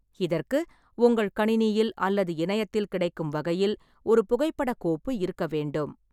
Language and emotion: Tamil, neutral